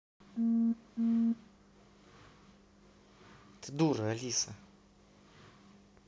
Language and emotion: Russian, angry